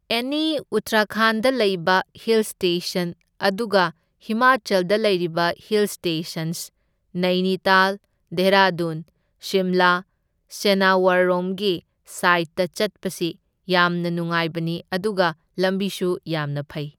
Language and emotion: Manipuri, neutral